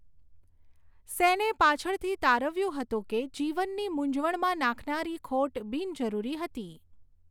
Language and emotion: Gujarati, neutral